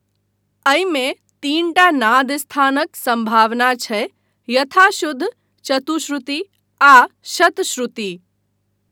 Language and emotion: Maithili, neutral